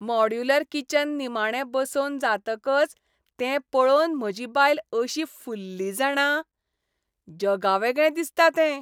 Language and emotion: Goan Konkani, happy